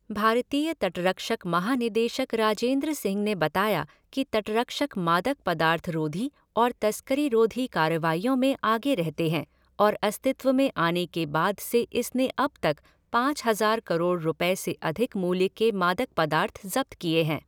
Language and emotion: Hindi, neutral